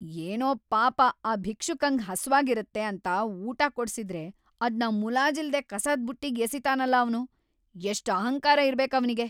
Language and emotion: Kannada, angry